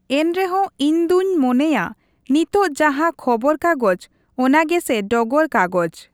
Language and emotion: Santali, neutral